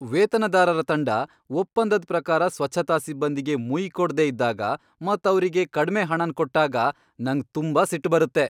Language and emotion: Kannada, angry